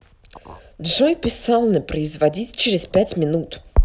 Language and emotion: Russian, angry